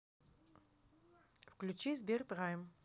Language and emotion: Russian, neutral